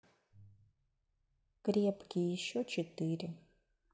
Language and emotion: Russian, neutral